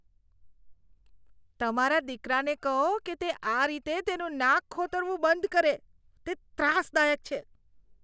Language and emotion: Gujarati, disgusted